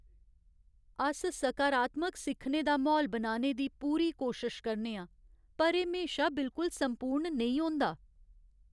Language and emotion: Dogri, sad